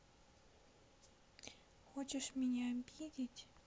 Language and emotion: Russian, sad